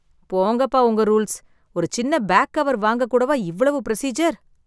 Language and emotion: Tamil, sad